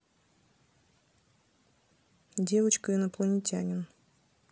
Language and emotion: Russian, neutral